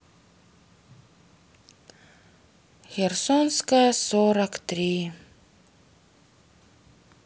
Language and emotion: Russian, sad